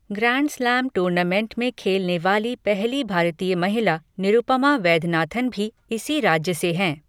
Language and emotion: Hindi, neutral